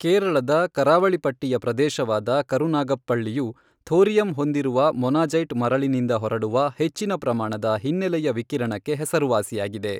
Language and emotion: Kannada, neutral